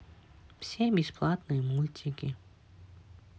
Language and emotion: Russian, neutral